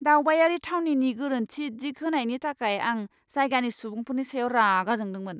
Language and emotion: Bodo, angry